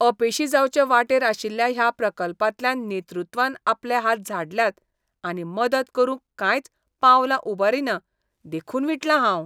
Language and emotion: Goan Konkani, disgusted